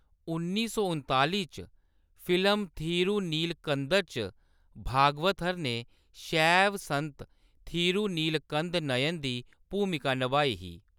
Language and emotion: Dogri, neutral